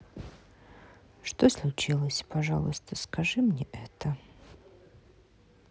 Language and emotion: Russian, sad